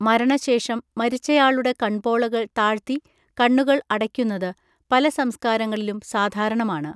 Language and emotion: Malayalam, neutral